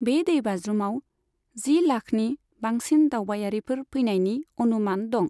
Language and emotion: Bodo, neutral